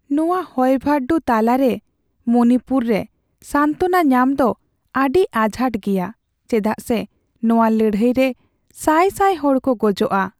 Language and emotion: Santali, sad